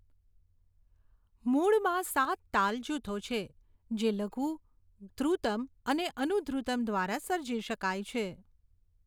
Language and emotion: Gujarati, neutral